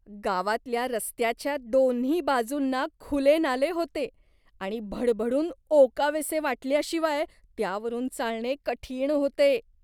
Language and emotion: Marathi, disgusted